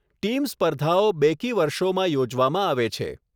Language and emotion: Gujarati, neutral